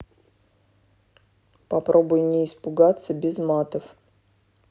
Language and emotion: Russian, neutral